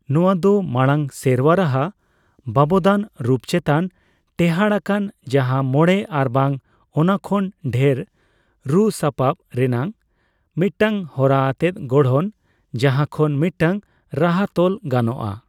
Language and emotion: Santali, neutral